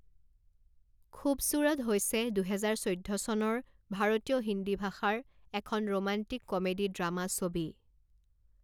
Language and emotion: Assamese, neutral